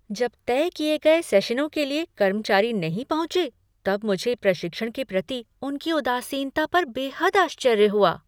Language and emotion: Hindi, surprised